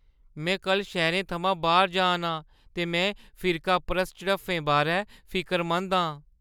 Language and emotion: Dogri, fearful